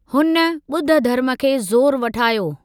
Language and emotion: Sindhi, neutral